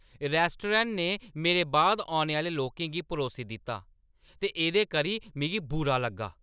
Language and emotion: Dogri, angry